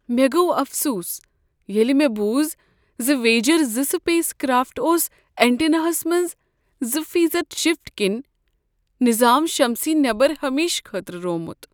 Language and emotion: Kashmiri, sad